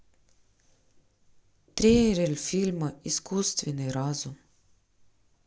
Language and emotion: Russian, sad